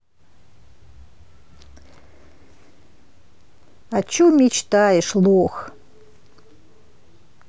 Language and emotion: Russian, neutral